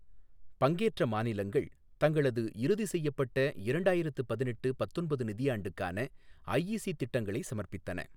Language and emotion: Tamil, neutral